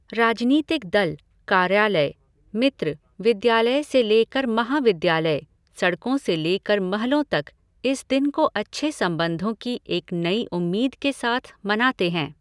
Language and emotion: Hindi, neutral